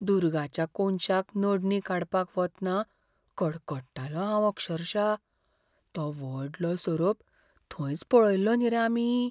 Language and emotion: Goan Konkani, fearful